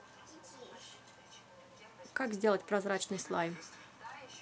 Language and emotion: Russian, neutral